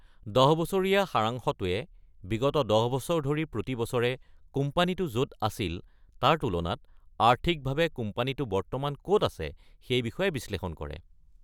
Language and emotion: Assamese, neutral